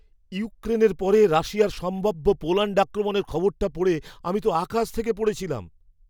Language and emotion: Bengali, surprised